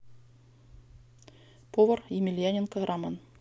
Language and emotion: Russian, neutral